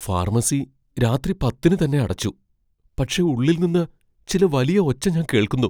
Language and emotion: Malayalam, fearful